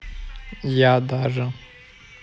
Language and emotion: Russian, neutral